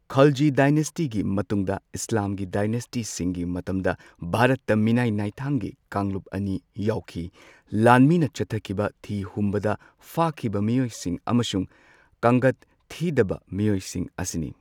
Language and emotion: Manipuri, neutral